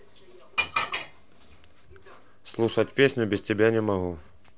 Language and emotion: Russian, neutral